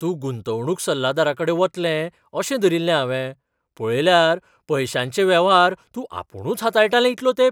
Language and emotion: Goan Konkani, surprised